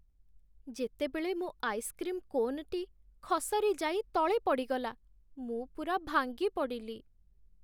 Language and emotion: Odia, sad